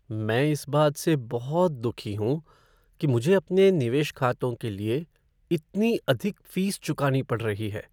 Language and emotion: Hindi, sad